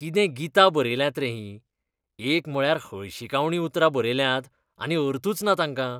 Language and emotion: Goan Konkani, disgusted